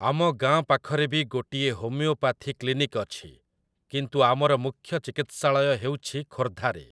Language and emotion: Odia, neutral